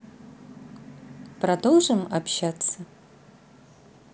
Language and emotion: Russian, positive